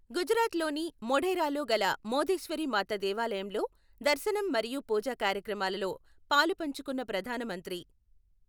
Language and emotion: Telugu, neutral